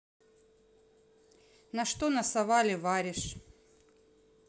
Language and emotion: Russian, neutral